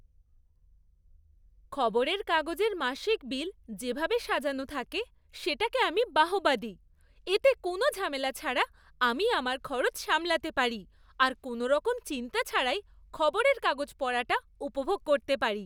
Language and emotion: Bengali, happy